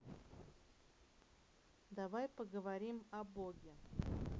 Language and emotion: Russian, neutral